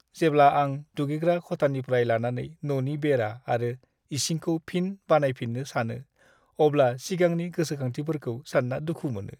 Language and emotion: Bodo, sad